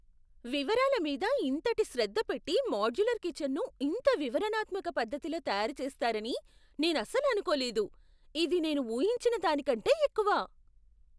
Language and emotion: Telugu, surprised